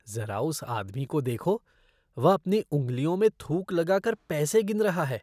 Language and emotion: Hindi, disgusted